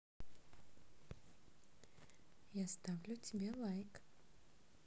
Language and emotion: Russian, positive